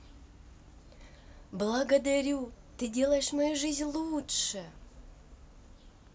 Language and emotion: Russian, positive